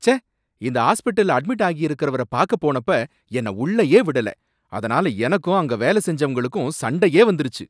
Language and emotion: Tamil, angry